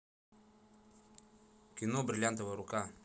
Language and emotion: Russian, neutral